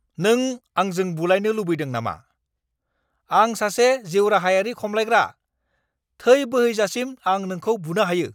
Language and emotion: Bodo, angry